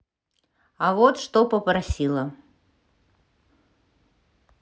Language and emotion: Russian, neutral